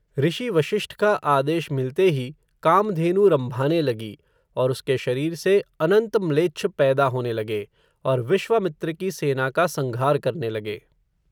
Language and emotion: Hindi, neutral